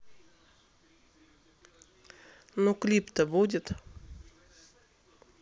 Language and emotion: Russian, neutral